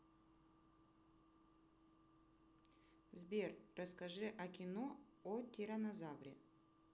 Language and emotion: Russian, neutral